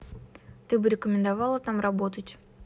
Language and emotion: Russian, neutral